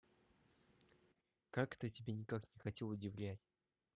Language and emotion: Russian, neutral